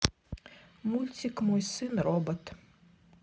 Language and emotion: Russian, neutral